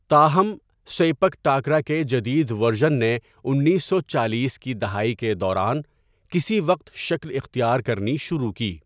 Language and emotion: Urdu, neutral